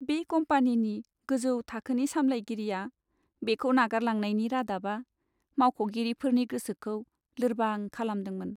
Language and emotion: Bodo, sad